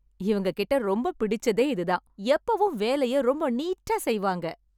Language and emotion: Tamil, happy